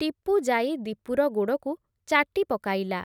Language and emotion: Odia, neutral